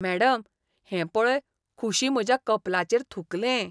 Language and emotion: Goan Konkani, disgusted